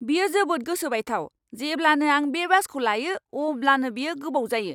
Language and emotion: Bodo, angry